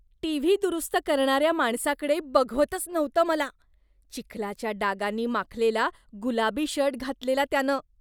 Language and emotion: Marathi, disgusted